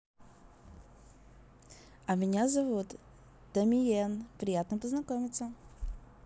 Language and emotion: Russian, positive